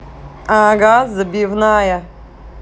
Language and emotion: Russian, neutral